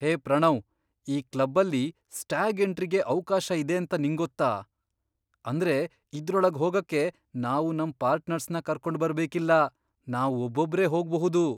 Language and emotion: Kannada, surprised